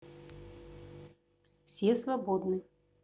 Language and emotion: Russian, neutral